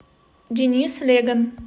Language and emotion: Russian, neutral